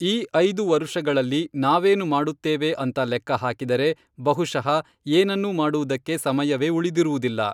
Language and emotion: Kannada, neutral